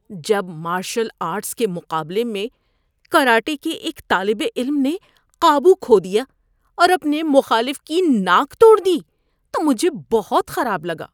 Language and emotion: Urdu, disgusted